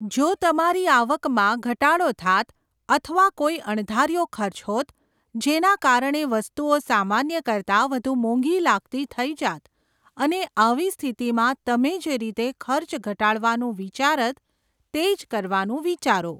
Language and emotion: Gujarati, neutral